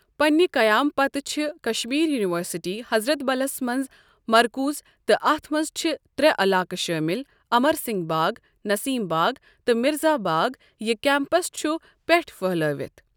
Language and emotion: Kashmiri, neutral